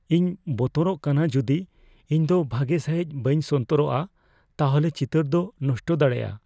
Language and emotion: Santali, fearful